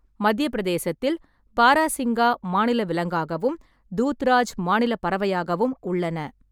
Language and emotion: Tamil, neutral